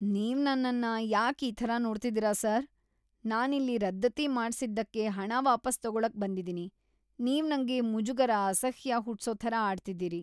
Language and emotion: Kannada, disgusted